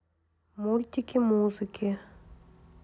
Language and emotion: Russian, neutral